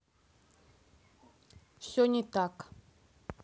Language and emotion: Russian, neutral